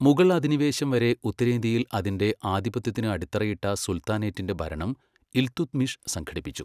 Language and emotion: Malayalam, neutral